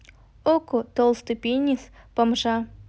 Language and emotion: Russian, neutral